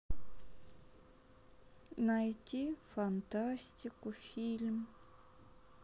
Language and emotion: Russian, sad